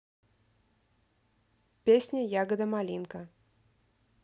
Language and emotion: Russian, neutral